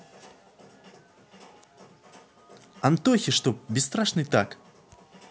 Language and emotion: Russian, positive